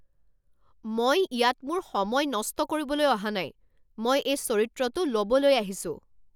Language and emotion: Assamese, angry